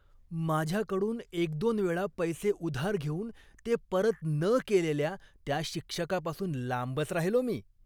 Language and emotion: Marathi, disgusted